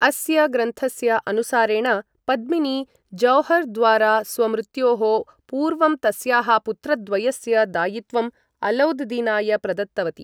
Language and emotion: Sanskrit, neutral